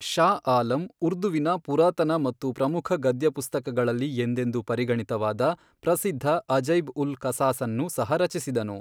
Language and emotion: Kannada, neutral